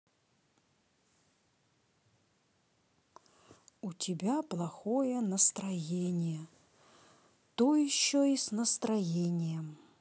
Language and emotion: Russian, sad